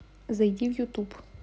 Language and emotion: Russian, neutral